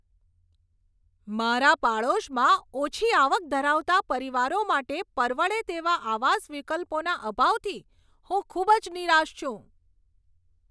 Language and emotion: Gujarati, angry